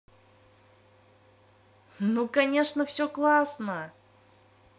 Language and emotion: Russian, positive